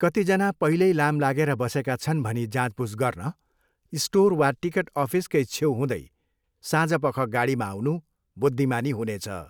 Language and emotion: Nepali, neutral